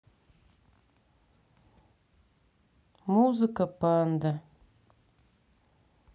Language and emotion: Russian, sad